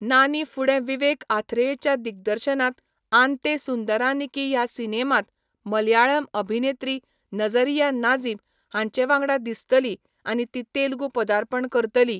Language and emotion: Goan Konkani, neutral